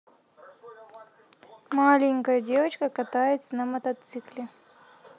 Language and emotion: Russian, neutral